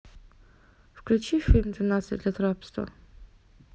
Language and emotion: Russian, neutral